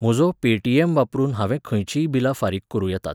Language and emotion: Goan Konkani, neutral